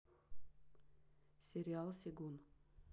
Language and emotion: Russian, neutral